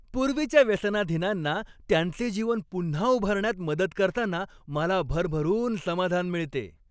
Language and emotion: Marathi, happy